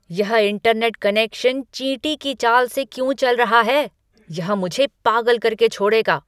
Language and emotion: Hindi, angry